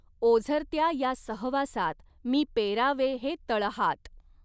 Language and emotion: Marathi, neutral